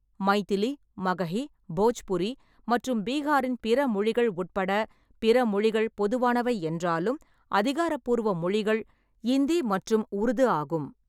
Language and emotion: Tamil, neutral